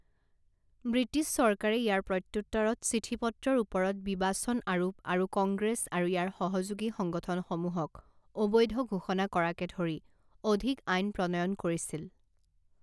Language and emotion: Assamese, neutral